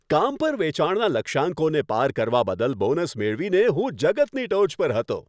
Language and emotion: Gujarati, happy